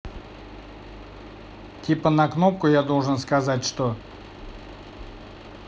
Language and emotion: Russian, neutral